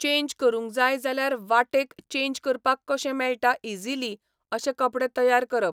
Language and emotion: Goan Konkani, neutral